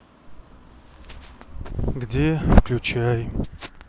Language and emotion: Russian, sad